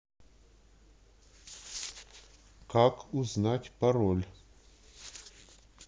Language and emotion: Russian, neutral